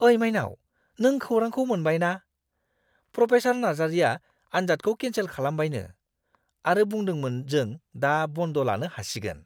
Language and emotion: Bodo, surprised